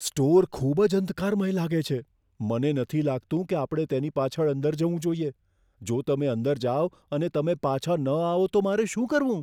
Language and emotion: Gujarati, fearful